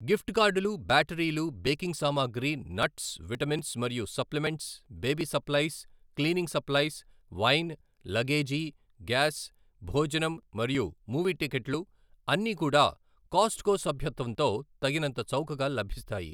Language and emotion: Telugu, neutral